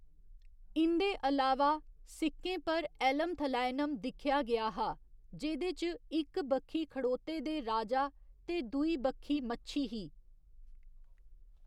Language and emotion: Dogri, neutral